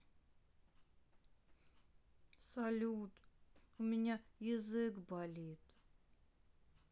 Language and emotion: Russian, sad